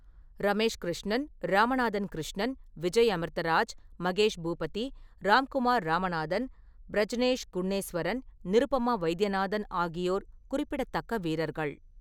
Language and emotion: Tamil, neutral